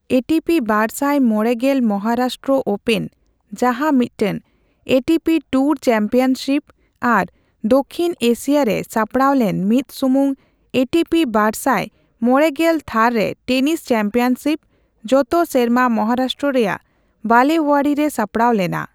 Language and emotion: Santali, neutral